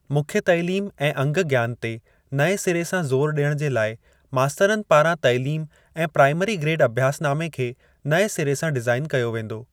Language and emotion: Sindhi, neutral